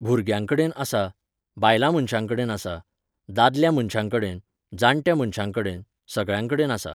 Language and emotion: Goan Konkani, neutral